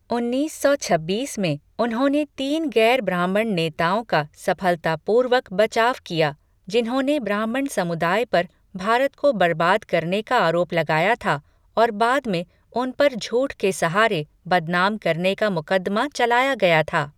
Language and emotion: Hindi, neutral